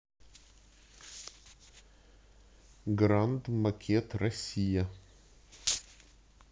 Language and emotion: Russian, neutral